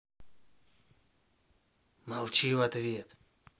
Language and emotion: Russian, angry